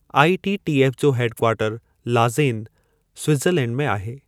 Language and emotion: Sindhi, neutral